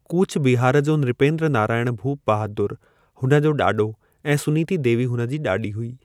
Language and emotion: Sindhi, neutral